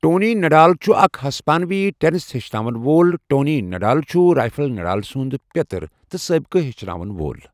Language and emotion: Kashmiri, neutral